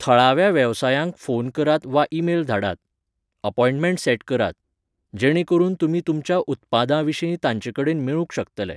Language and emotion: Goan Konkani, neutral